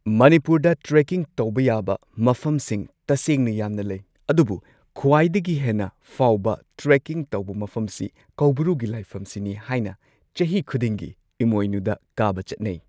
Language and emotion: Manipuri, neutral